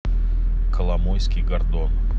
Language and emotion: Russian, neutral